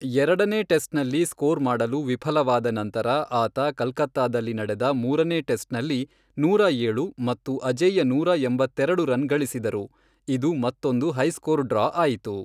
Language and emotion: Kannada, neutral